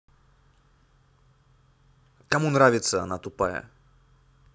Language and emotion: Russian, angry